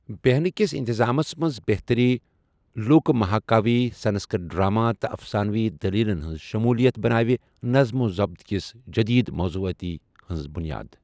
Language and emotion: Kashmiri, neutral